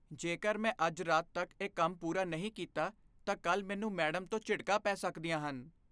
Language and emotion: Punjabi, fearful